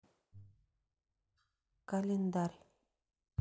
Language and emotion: Russian, neutral